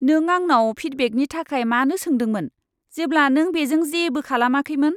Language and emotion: Bodo, disgusted